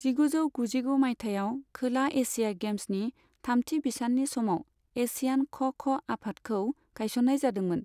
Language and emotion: Bodo, neutral